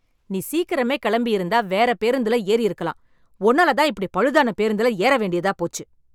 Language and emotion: Tamil, angry